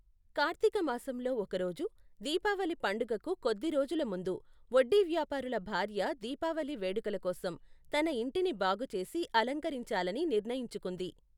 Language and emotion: Telugu, neutral